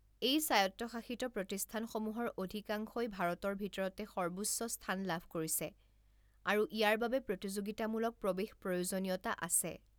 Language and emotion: Assamese, neutral